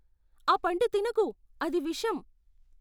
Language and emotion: Telugu, fearful